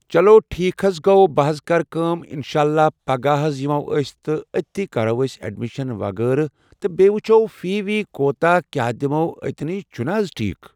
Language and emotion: Kashmiri, neutral